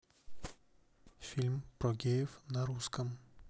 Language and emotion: Russian, neutral